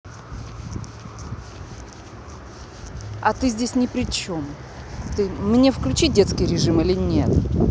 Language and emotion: Russian, angry